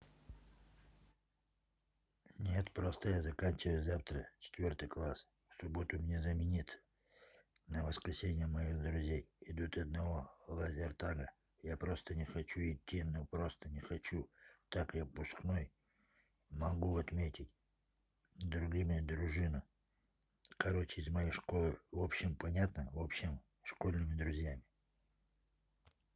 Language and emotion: Russian, neutral